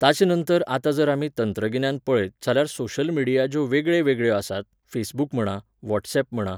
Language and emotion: Goan Konkani, neutral